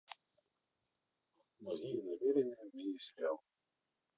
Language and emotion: Russian, neutral